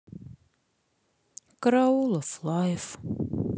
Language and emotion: Russian, sad